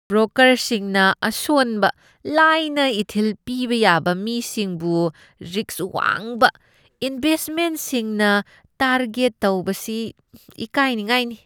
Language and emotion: Manipuri, disgusted